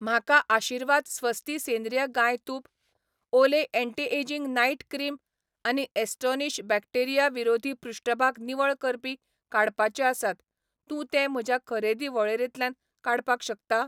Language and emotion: Goan Konkani, neutral